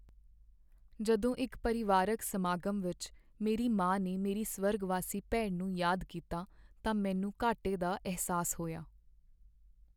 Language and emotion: Punjabi, sad